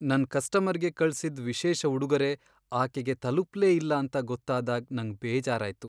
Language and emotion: Kannada, sad